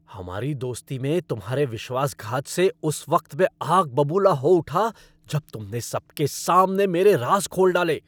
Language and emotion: Hindi, angry